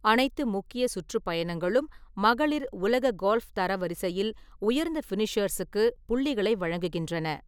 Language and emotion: Tamil, neutral